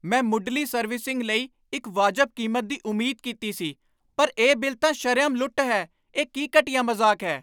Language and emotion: Punjabi, angry